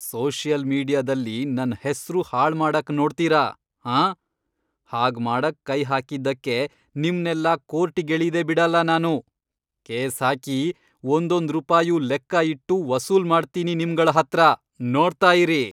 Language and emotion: Kannada, angry